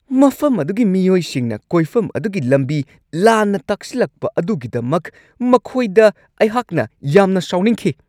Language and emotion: Manipuri, angry